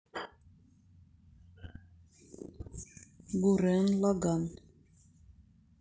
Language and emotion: Russian, neutral